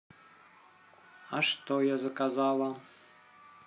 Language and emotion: Russian, neutral